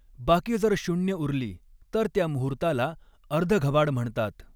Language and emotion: Marathi, neutral